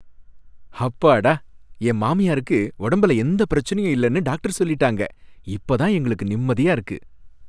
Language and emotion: Tamil, happy